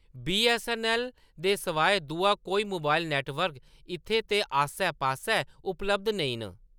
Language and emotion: Dogri, neutral